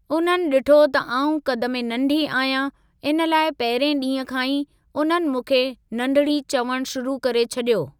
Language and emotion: Sindhi, neutral